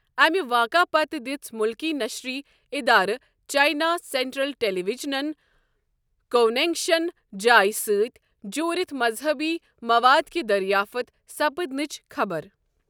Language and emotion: Kashmiri, neutral